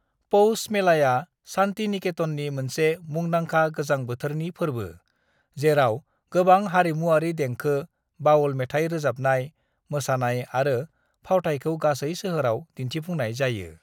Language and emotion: Bodo, neutral